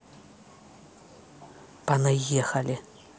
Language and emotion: Russian, angry